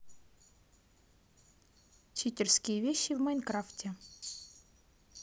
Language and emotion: Russian, neutral